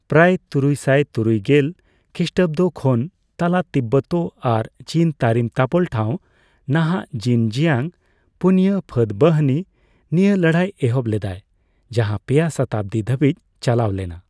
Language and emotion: Santali, neutral